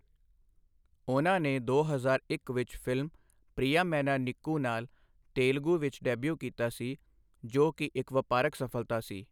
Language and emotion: Punjabi, neutral